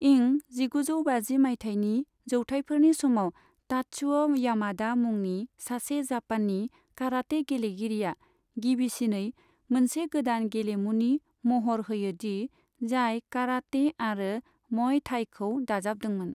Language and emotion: Bodo, neutral